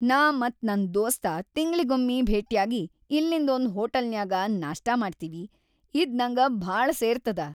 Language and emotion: Kannada, happy